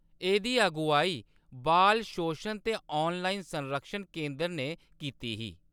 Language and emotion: Dogri, neutral